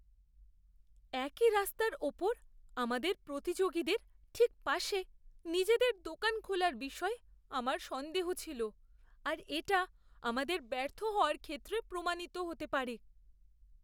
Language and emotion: Bengali, fearful